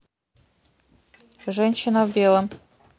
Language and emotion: Russian, neutral